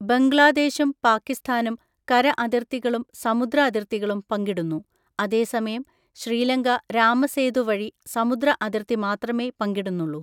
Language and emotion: Malayalam, neutral